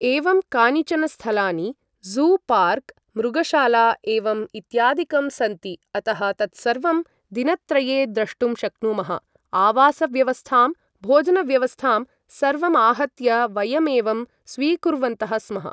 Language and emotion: Sanskrit, neutral